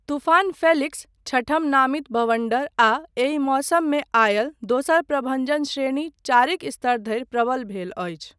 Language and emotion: Maithili, neutral